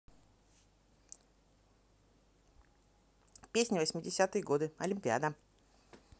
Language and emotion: Russian, positive